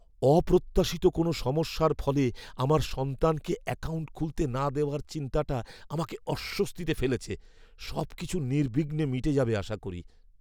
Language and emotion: Bengali, fearful